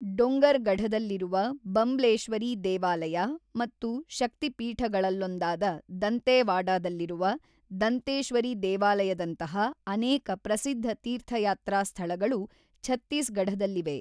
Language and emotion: Kannada, neutral